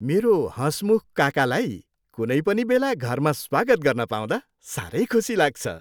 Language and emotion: Nepali, happy